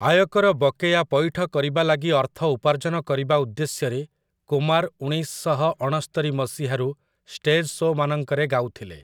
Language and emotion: Odia, neutral